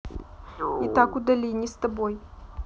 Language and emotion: Russian, neutral